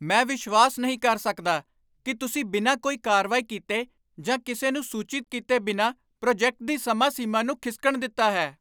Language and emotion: Punjabi, angry